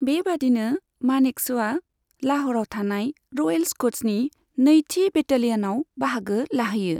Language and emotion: Bodo, neutral